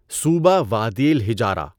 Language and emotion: Urdu, neutral